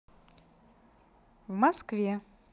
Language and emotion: Russian, positive